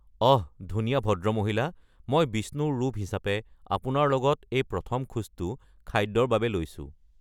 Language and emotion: Assamese, neutral